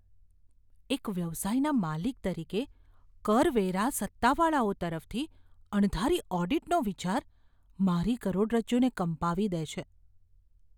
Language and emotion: Gujarati, fearful